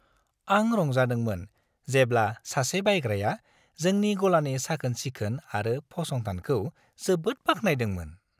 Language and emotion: Bodo, happy